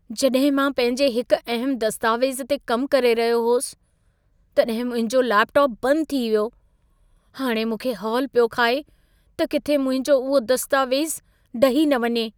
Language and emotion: Sindhi, fearful